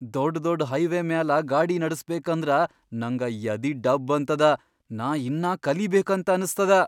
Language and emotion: Kannada, fearful